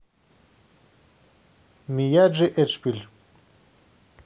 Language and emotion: Russian, neutral